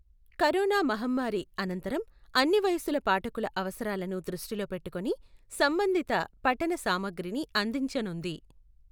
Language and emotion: Telugu, neutral